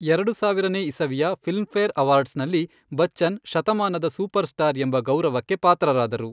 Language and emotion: Kannada, neutral